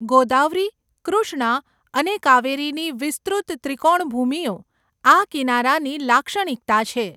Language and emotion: Gujarati, neutral